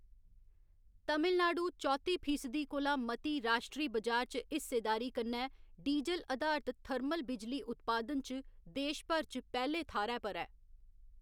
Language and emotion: Dogri, neutral